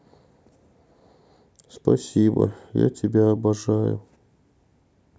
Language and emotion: Russian, sad